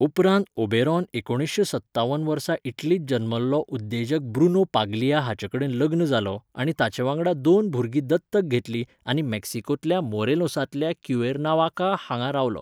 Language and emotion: Goan Konkani, neutral